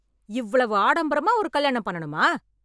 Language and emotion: Tamil, angry